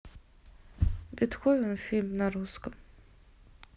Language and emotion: Russian, neutral